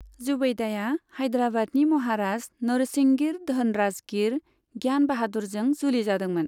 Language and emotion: Bodo, neutral